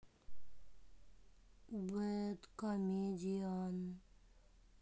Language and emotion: Russian, sad